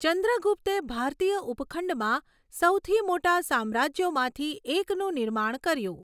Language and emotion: Gujarati, neutral